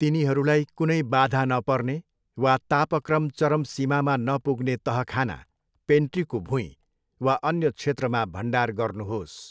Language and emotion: Nepali, neutral